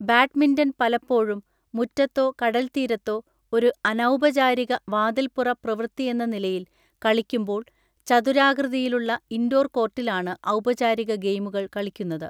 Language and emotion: Malayalam, neutral